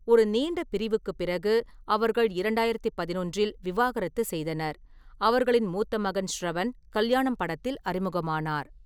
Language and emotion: Tamil, neutral